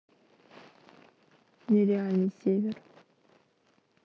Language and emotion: Russian, sad